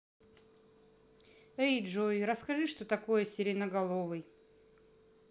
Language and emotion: Russian, neutral